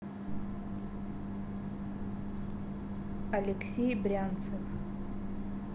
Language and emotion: Russian, neutral